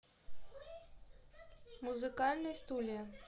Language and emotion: Russian, neutral